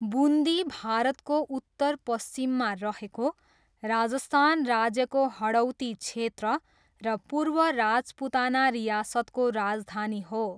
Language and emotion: Nepali, neutral